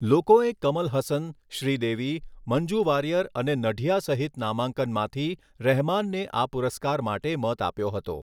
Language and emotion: Gujarati, neutral